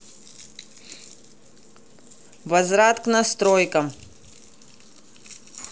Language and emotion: Russian, angry